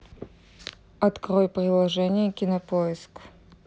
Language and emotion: Russian, neutral